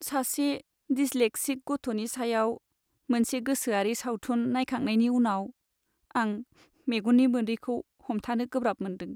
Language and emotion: Bodo, sad